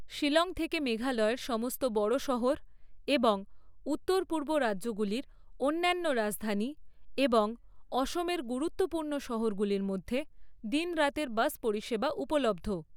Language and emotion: Bengali, neutral